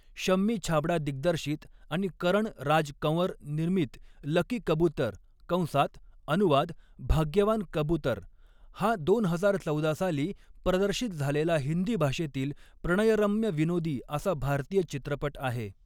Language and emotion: Marathi, neutral